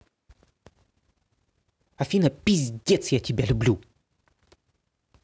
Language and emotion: Russian, angry